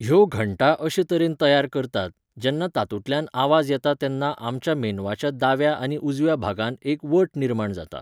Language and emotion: Goan Konkani, neutral